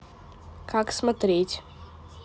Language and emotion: Russian, neutral